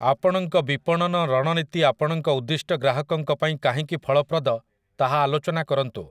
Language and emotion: Odia, neutral